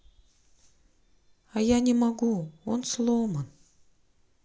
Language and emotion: Russian, sad